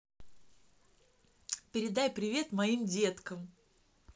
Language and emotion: Russian, positive